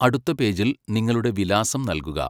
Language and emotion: Malayalam, neutral